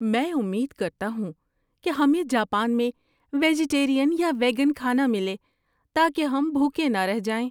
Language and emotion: Urdu, fearful